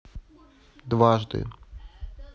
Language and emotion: Russian, neutral